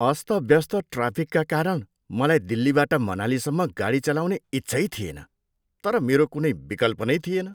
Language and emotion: Nepali, disgusted